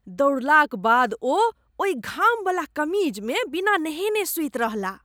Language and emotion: Maithili, disgusted